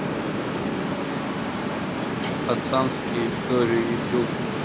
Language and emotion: Russian, neutral